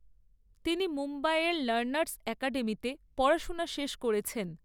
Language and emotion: Bengali, neutral